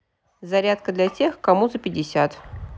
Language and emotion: Russian, neutral